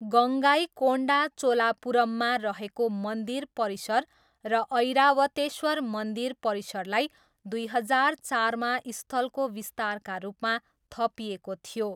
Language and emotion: Nepali, neutral